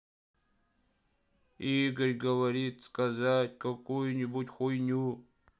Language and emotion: Russian, sad